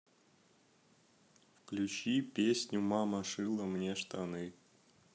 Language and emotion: Russian, neutral